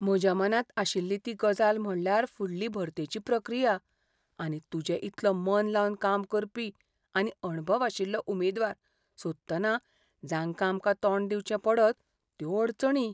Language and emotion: Goan Konkani, fearful